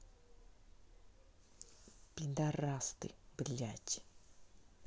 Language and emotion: Russian, angry